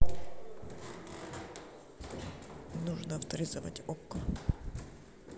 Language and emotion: Russian, neutral